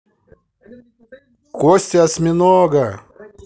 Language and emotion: Russian, positive